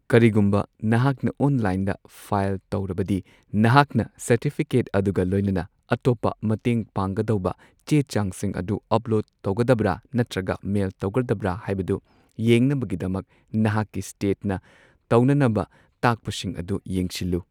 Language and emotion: Manipuri, neutral